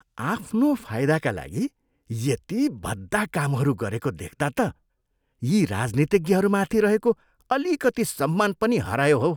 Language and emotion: Nepali, disgusted